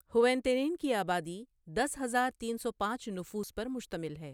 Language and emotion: Urdu, neutral